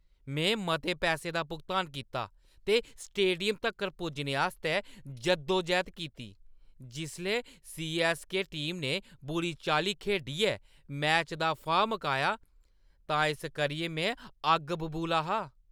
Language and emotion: Dogri, angry